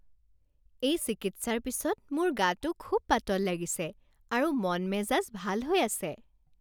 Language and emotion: Assamese, happy